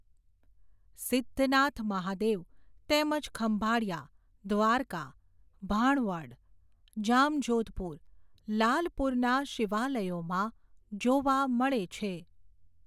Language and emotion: Gujarati, neutral